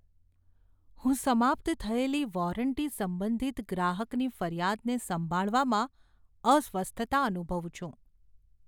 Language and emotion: Gujarati, fearful